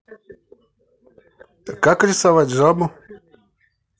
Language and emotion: Russian, neutral